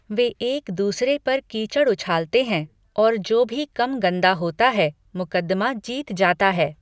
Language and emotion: Hindi, neutral